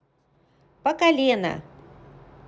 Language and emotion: Russian, neutral